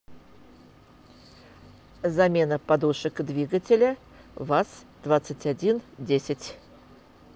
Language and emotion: Russian, neutral